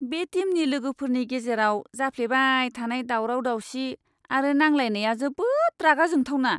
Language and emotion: Bodo, disgusted